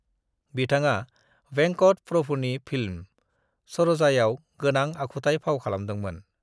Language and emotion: Bodo, neutral